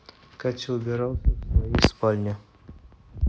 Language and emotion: Russian, neutral